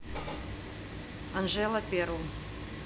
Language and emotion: Russian, neutral